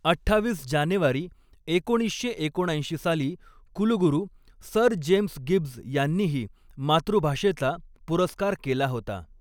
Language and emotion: Marathi, neutral